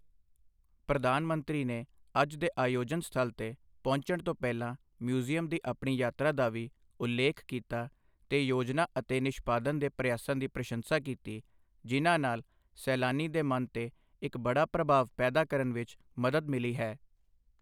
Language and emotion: Punjabi, neutral